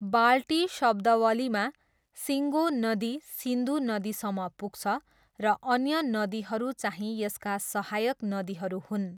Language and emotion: Nepali, neutral